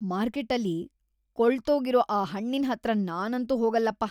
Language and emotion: Kannada, disgusted